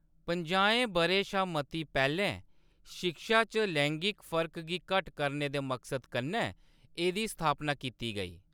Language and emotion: Dogri, neutral